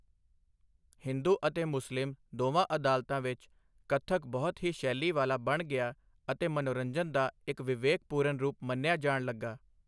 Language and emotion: Punjabi, neutral